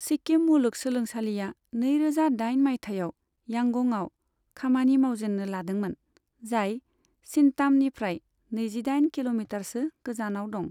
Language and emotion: Bodo, neutral